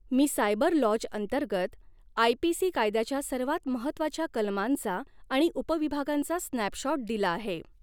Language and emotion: Marathi, neutral